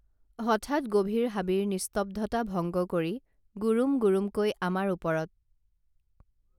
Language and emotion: Assamese, neutral